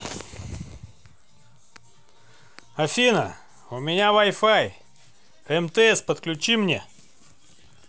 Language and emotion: Russian, neutral